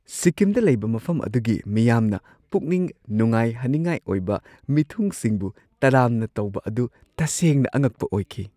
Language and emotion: Manipuri, surprised